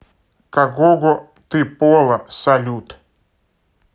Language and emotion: Russian, neutral